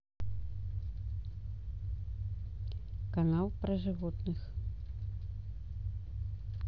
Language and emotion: Russian, neutral